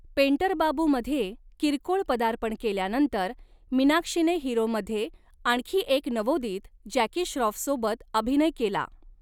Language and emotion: Marathi, neutral